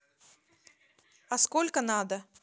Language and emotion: Russian, neutral